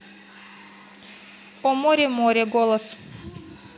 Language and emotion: Russian, neutral